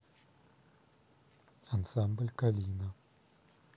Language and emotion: Russian, neutral